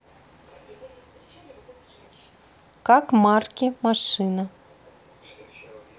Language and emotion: Russian, neutral